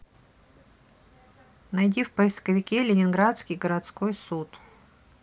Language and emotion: Russian, neutral